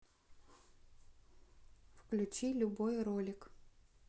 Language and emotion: Russian, neutral